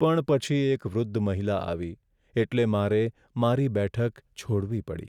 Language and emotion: Gujarati, sad